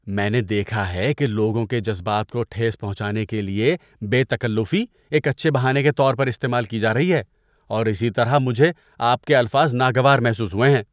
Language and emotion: Urdu, disgusted